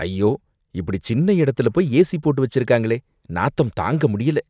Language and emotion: Tamil, disgusted